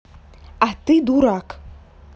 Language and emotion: Russian, angry